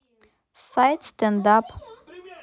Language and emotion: Russian, neutral